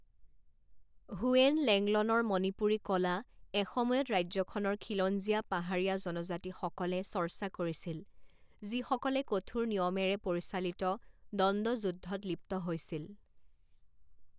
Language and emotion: Assamese, neutral